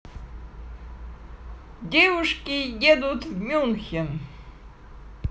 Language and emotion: Russian, positive